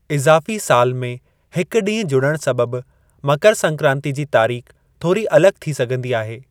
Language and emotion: Sindhi, neutral